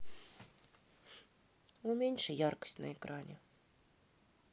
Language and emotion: Russian, sad